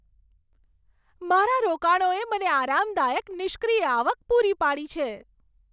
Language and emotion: Gujarati, happy